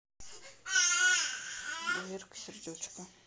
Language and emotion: Russian, neutral